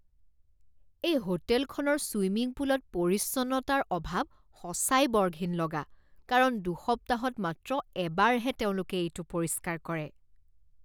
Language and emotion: Assamese, disgusted